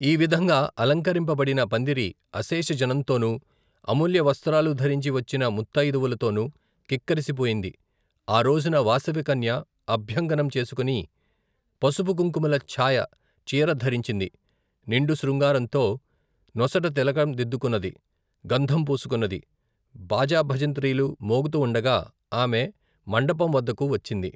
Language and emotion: Telugu, neutral